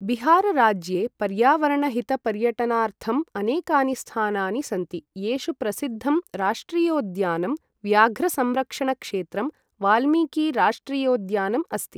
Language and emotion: Sanskrit, neutral